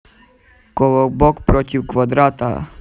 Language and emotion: Russian, neutral